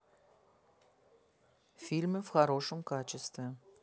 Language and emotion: Russian, neutral